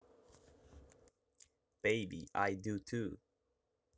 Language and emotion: Russian, positive